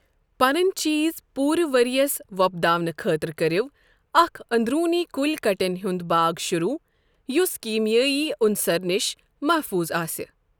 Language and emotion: Kashmiri, neutral